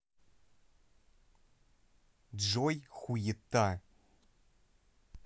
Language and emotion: Russian, neutral